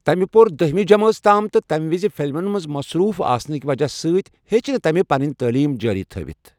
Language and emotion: Kashmiri, neutral